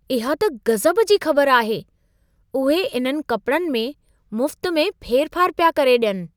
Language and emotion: Sindhi, surprised